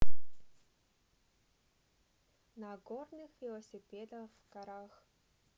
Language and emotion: Russian, neutral